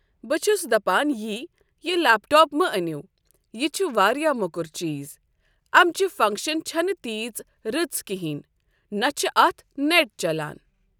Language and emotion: Kashmiri, neutral